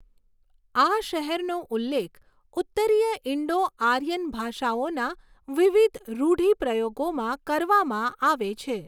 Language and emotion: Gujarati, neutral